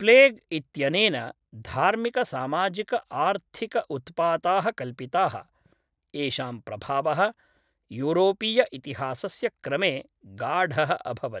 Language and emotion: Sanskrit, neutral